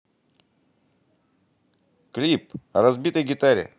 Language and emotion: Russian, positive